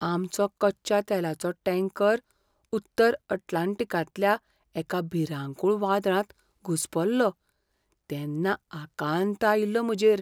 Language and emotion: Goan Konkani, fearful